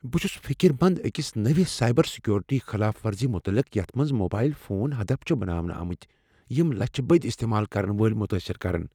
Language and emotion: Kashmiri, fearful